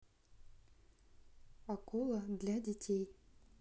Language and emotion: Russian, neutral